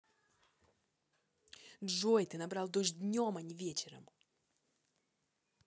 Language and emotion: Russian, angry